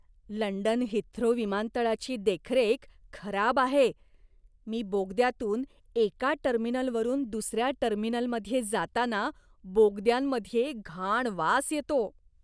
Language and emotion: Marathi, disgusted